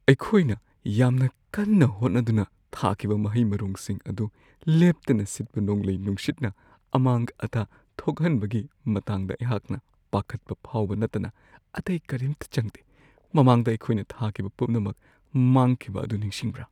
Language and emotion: Manipuri, fearful